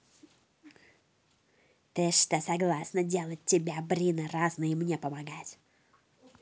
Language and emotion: Russian, angry